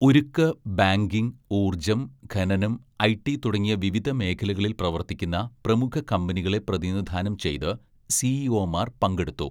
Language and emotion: Malayalam, neutral